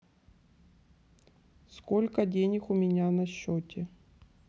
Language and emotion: Russian, neutral